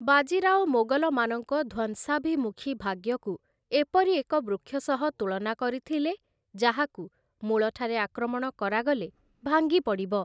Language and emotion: Odia, neutral